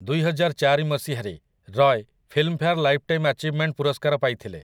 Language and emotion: Odia, neutral